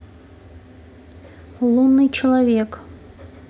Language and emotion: Russian, neutral